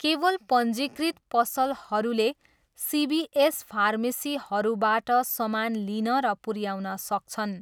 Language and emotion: Nepali, neutral